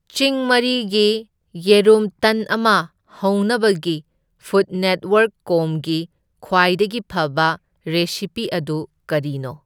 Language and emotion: Manipuri, neutral